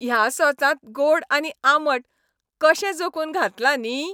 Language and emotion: Goan Konkani, happy